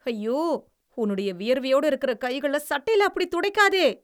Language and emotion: Tamil, disgusted